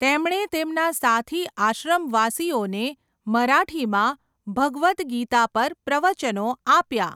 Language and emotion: Gujarati, neutral